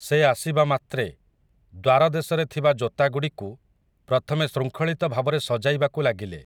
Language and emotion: Odia, neutral